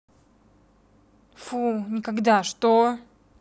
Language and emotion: Russian, angry